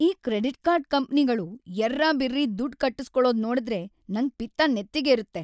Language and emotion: Kannada, angry